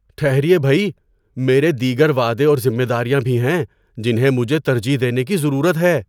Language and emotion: Urdu, surprised